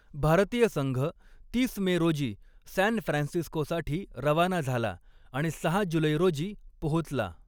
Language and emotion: Marathi, neutral